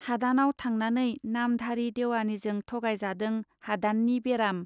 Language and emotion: Bodo, neutral